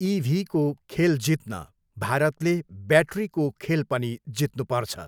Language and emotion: Nepali, neutral